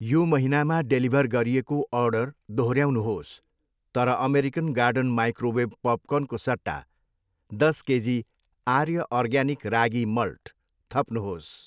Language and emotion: Nepali, neutral